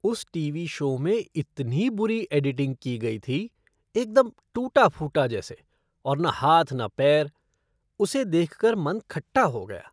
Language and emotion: Hindi, disgusted